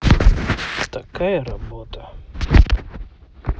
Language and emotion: Russian, sad